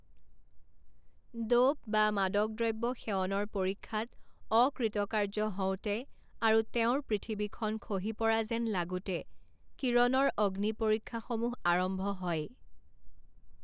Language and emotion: Assamese, neutral